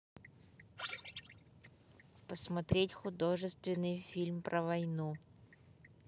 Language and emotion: Russian, neutral